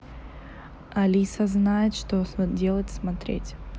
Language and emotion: Russian, neutral